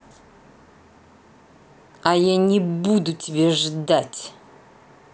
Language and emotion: Russian, angry